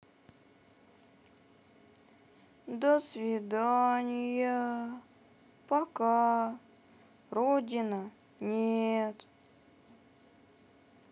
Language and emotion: Russian, sad